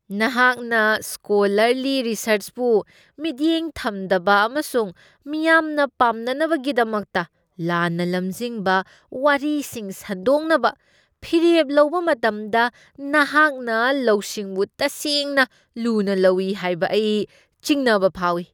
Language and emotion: Manipuri, disgusted